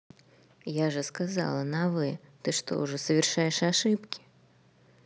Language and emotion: Russian, neutral